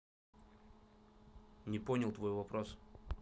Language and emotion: Russian, neutral